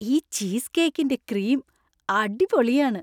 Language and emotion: Malayalam, happy